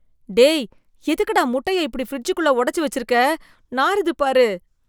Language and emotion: Tamil, disgusted